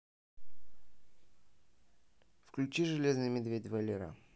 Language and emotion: Russian, neutral